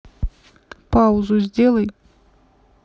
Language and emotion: Russian, neutral